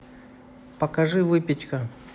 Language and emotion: Russian, neutral